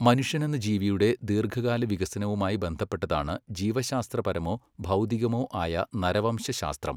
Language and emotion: Malayalam, neutral